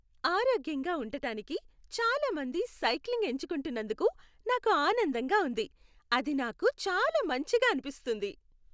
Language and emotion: Telugu, happy